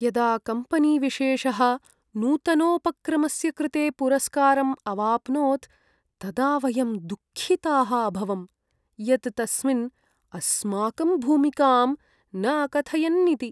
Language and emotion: Sanskrit, sad